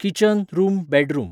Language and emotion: Goan Konkani, neutral